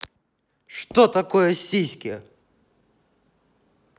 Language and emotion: Russian, angry